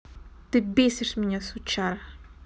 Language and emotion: Russian, angry